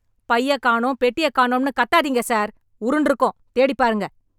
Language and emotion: Tamil, angry